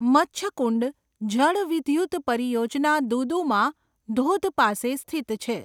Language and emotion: Gujarati, neutral